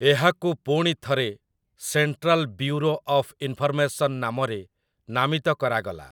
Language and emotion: Odia, neutral